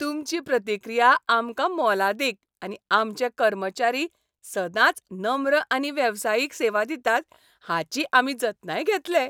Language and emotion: Goan Konkani, happy